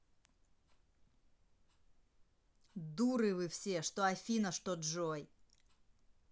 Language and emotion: Russian, angry